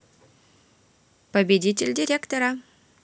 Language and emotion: Russian, neutral